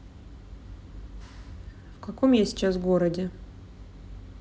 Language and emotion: Russian, neutral